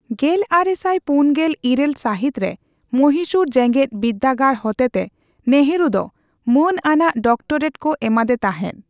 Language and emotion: Santali, neutral